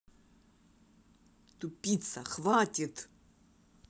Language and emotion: Russian, angry